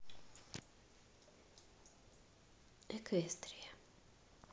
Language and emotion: Russian, neutral